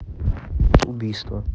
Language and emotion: Russian, neutral